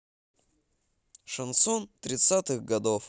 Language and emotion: Russian, positive